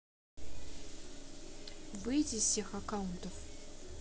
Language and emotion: Russian, neutral